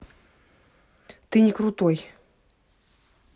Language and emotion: Russian, angry